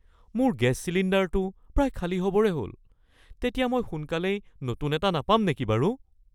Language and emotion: Assamese, fearful